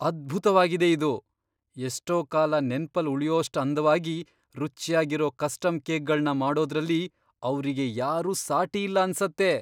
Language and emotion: Kannada, surprised